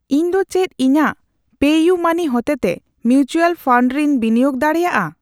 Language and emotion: Santali, neutral